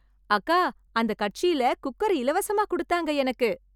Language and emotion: Tamil, happy